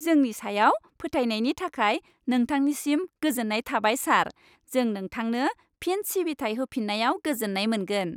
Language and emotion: Bodo, happy